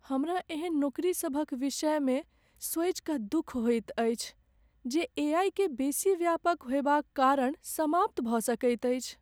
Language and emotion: Maithili, sad